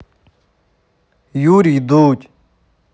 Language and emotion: Russian, neutral